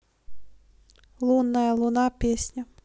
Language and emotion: Russian, neutral